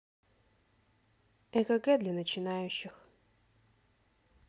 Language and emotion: Russian, neutral